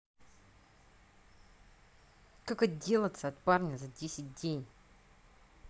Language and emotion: Russian, angry